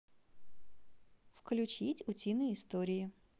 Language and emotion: Russian, positive